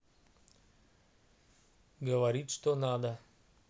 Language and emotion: Russian, neutral